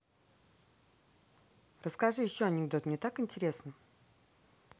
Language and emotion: Russian, positive